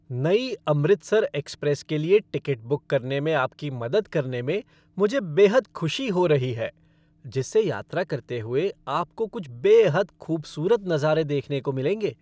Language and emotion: Hindi, happy